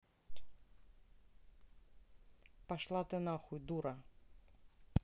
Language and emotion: Russian, neutral